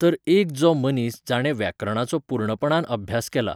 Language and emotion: Goan Konkani, neutral